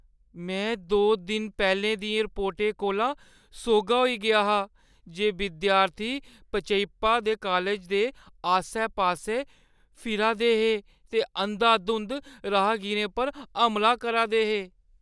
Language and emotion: Dogri, fearful